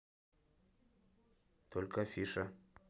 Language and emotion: Russian, neutral